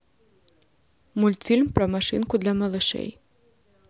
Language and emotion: Russian, neutral